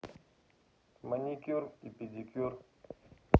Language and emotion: Russian, neutral